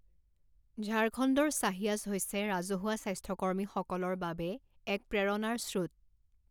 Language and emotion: Assamese, neutral